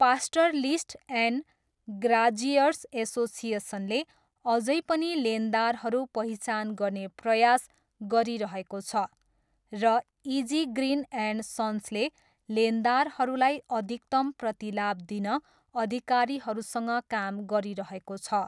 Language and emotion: Nepali, neutral